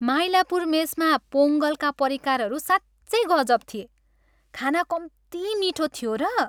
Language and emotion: Nepali, happy